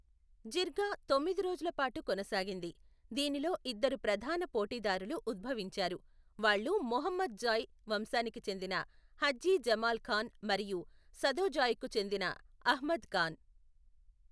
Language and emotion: Telugu, neutral